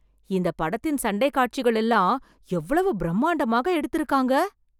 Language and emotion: Tamil, surprised